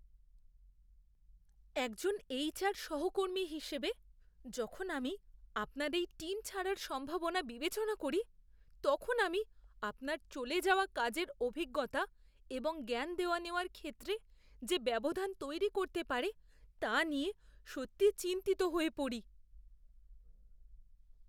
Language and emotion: Bengali, fearful